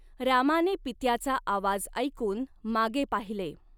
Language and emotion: Marathi, neutral